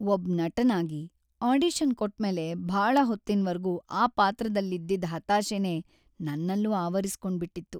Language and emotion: Kannada, sad